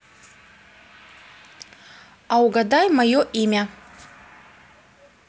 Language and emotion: Russian, neutral